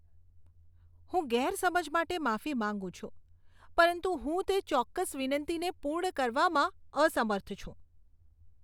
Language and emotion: Gujarati, disgusted